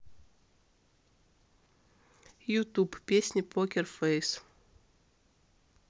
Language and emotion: Russian, neutral